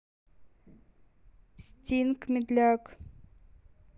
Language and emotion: Russian, neutral